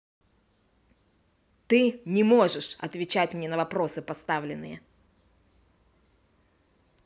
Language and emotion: Russian, angry